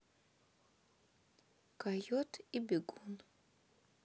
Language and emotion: Russian, neutral